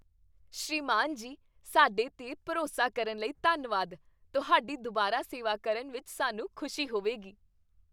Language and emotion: Punjabi, happy